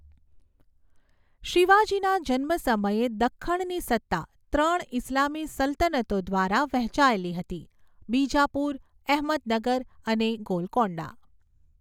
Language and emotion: Gujarati, neutral